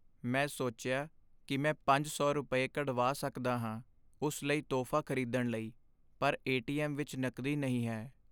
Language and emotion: Punjabi, sad